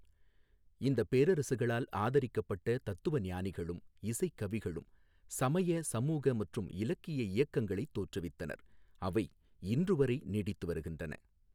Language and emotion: Tamil, neutral